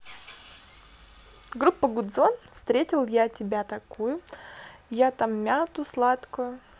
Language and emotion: Russian, positive